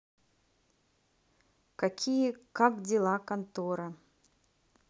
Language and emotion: Russian, neutral